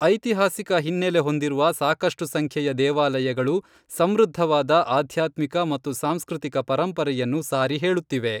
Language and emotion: Kannada, neutral